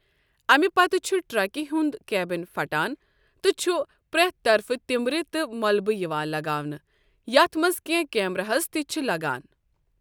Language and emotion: Kashmiri, neutral